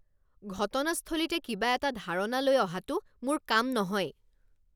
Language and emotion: Assamese, angry